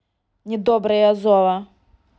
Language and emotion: Russian, angry